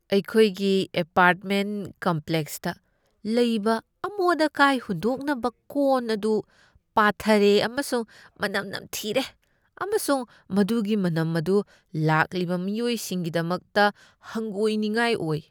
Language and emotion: Manipuri, disgusted